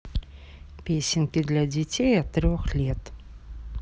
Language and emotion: Russian, neutral